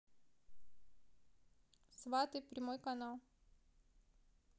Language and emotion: Russian, neutral